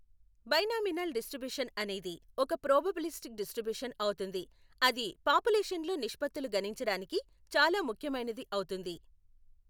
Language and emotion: Telugu, neutral